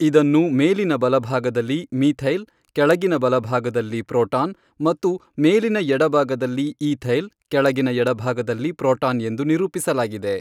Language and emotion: Kannada, neutral